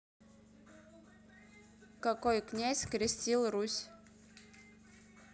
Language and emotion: Russian, neutral